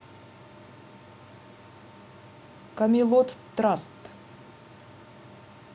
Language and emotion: Russian, neutral